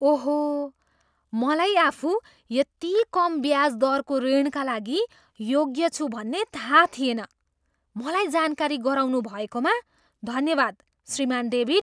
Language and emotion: Nepali, surprised